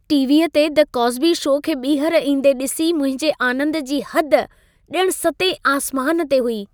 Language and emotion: Sindhi, happy